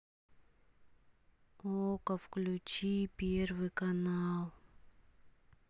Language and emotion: Russian, sad